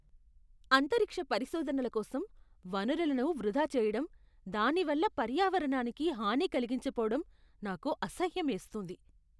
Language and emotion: Telugu, disgusted